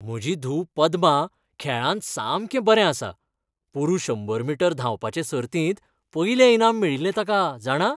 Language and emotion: Goan Konkani, happy